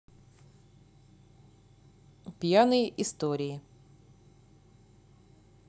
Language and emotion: Russian, neutral